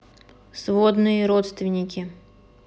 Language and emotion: Russian, neutral